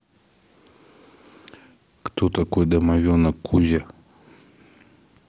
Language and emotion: Russian, neutral